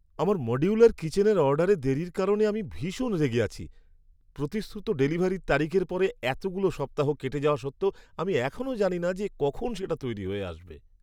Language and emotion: Bengali, angry